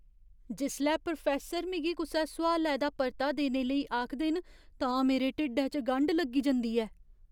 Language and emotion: Dogri, fearful